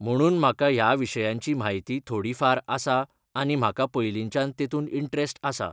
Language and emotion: Goan Konkani, neutral